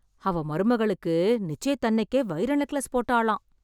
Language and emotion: Tamil, surprised